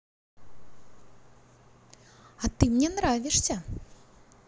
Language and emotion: Russian, positive